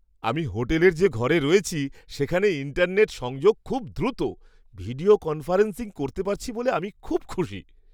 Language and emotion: Bengali, happy